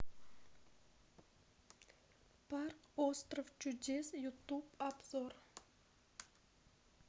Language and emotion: Russian, sad